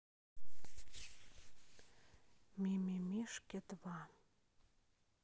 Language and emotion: Russian, sad